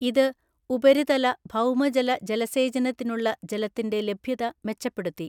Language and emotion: Malayalam, neutral